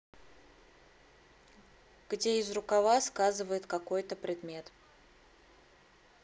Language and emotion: Russian, neutral